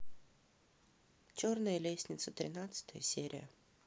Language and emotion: Russian, neutral